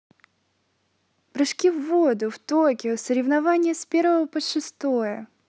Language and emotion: Russian, positive